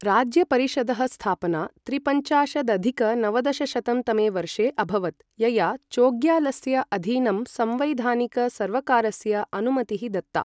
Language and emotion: Sanskrit, neutral